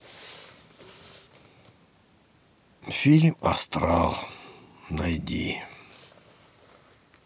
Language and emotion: Russian, sad